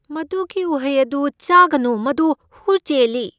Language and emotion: Manipuri, fearful